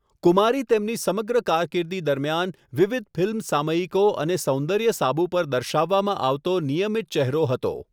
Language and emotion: Gujarati, neutral